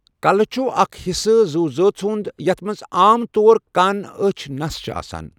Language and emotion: Kashmiri, neutral